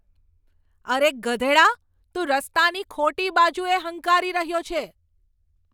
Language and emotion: Gujarati, angry